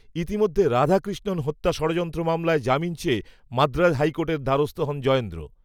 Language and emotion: Bengali, neutral